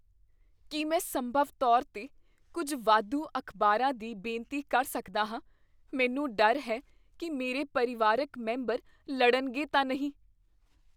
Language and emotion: Punjabi, fearful